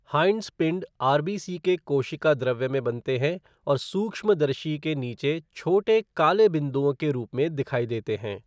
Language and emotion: Hindi, neutral